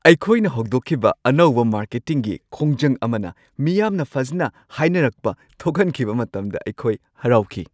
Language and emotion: Manipuri, happy